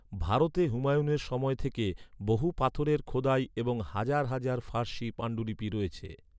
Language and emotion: Bengali, neutral